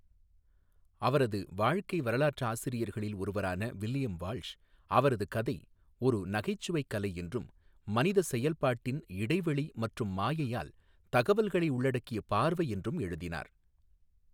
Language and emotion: Tamil, neutral